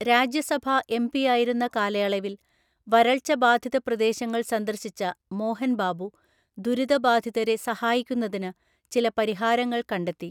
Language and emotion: Malayalam, neutral